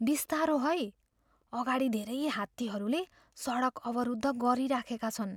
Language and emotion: Nepali, fearful